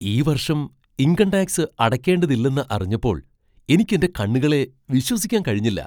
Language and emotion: Malayalam, surprised